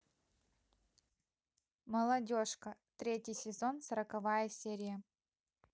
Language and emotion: Russian, neutral